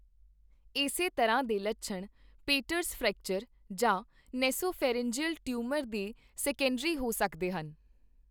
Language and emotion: Punjabi, neutral